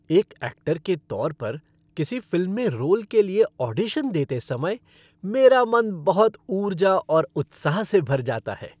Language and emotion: Hindi, happy